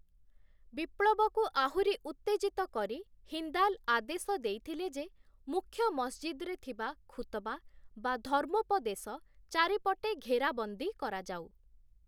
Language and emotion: Odia, neutral